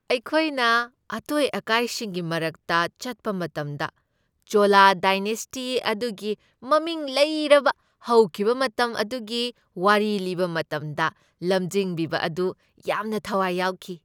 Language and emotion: Manipuri, happy